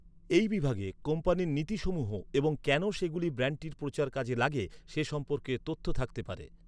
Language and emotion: Bengali, neutral